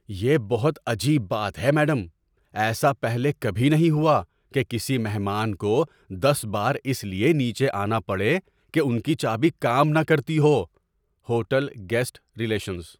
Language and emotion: Urdu, surprised